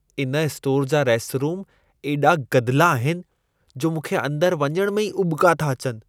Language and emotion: Sindhi, disgusted